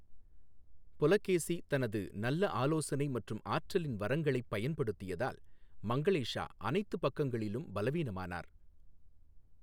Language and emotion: Tamil, neutral